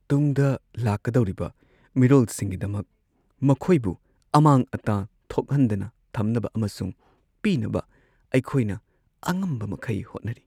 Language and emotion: Manipuri, sad